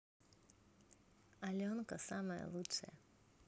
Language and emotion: Russian, positive